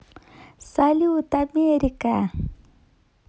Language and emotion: Russian, positive